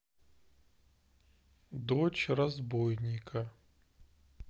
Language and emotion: Russian, neutral